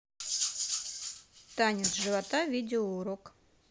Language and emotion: Russian, neutral